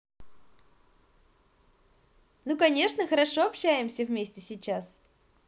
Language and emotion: Russian, positive